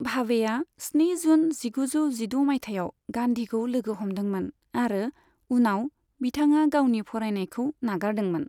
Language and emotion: Bodo, neutral